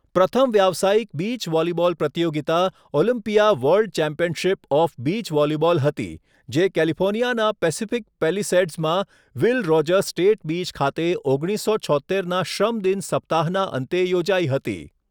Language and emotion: Gujarati, neutral